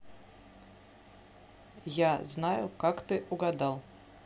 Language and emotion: Russian, neutral